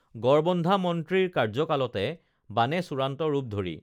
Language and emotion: Assamese, neutral